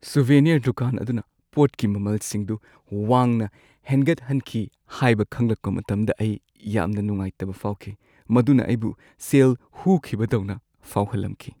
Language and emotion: Manipuri, sad